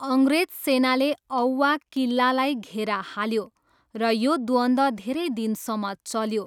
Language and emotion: Nepali, neutral